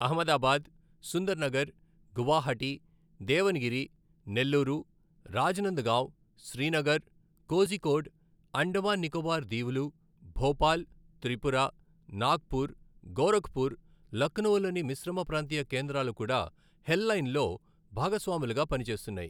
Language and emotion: Telugu, neutral